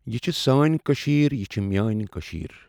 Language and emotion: Kashmiri, neutral